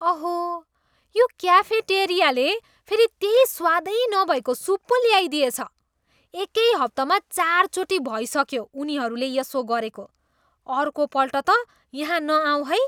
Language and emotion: Nepali, disgusted